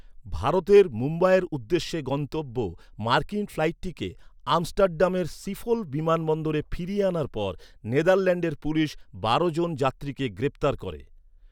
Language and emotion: Bengali, neutral